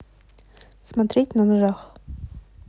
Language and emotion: Russian, neutral